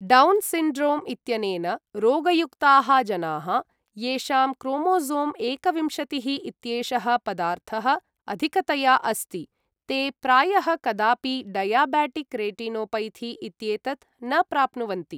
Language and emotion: Sanskrit, neutral